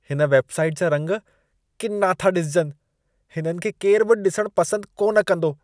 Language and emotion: Sindhi, disgusted